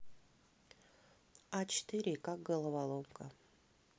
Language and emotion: Russian, neutral